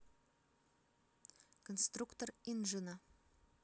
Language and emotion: Russian, neutral